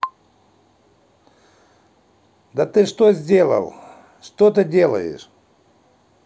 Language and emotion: Russian, angry